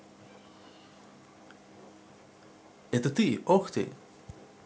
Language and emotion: Russian, positive